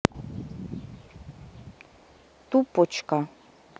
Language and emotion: Russian, neutral